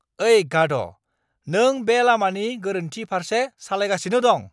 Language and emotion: Bodo, angry